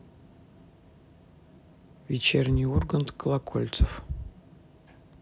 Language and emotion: Russian, neutral